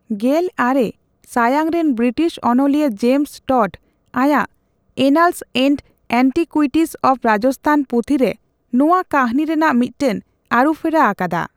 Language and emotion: Santali, neutral